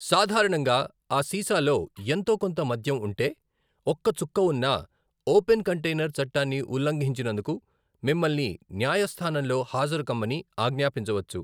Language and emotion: Telugu, neutral